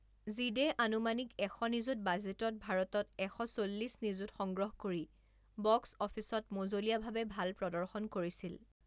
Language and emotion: Assamese, neutral